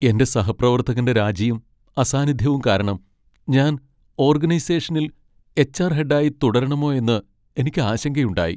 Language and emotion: Malayalam, sad